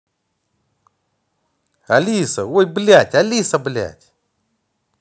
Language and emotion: Russian, neutral